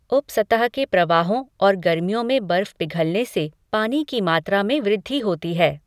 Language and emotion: Hindi, neutral